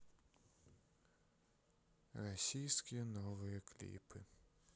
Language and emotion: Russian, sad